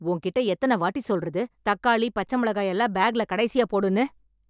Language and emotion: Tamil, angry